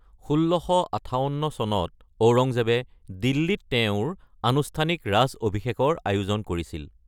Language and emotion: Assamese, neutral